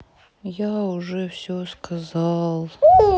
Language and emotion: Russian, sad